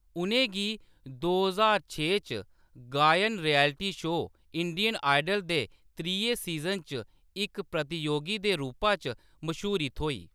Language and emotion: Dogri, neutral